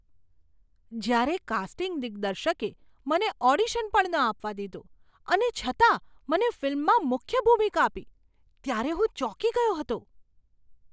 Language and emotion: Gujarati, surprised